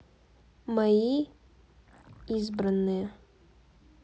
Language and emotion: Russian, neutral